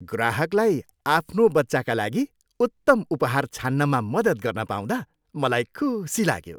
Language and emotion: Nepali, happy